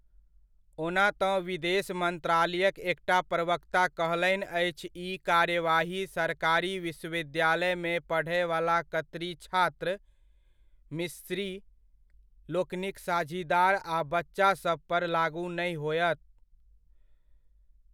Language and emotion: Maithili, neutral